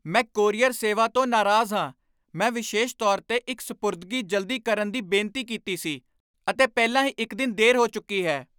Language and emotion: Punjabi, angry